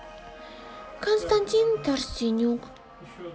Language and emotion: Russian, sad